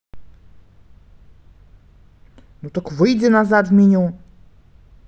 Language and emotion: Russian, angry